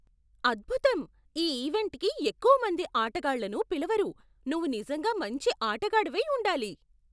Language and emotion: Telugu, surprised